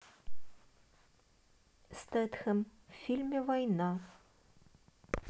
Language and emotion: Russian, neutral